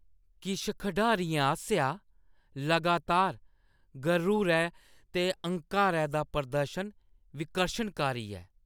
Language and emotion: Dogri, disgusted